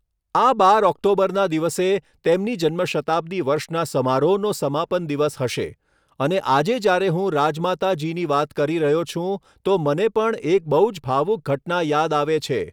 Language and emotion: Gujarati, neutral